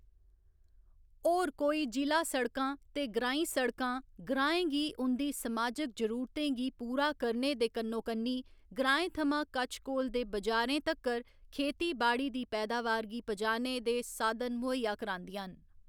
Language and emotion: Dogri, neutral